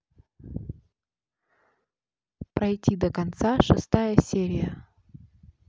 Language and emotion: Russian, neutral